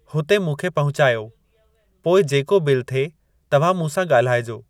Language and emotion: Sindhi, neutral